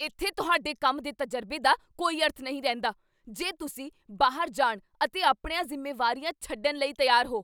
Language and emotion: Punjabi, angry